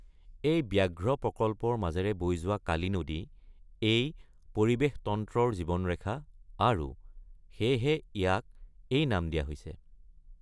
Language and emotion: Assamese, neutral